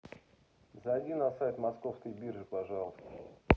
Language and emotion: Russian, neutral